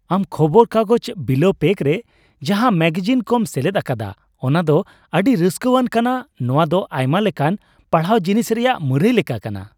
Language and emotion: Santali, happy